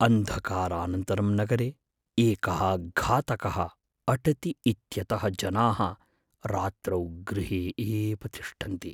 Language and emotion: Sanskrit, fearful